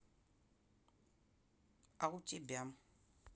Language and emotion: Russian, neutral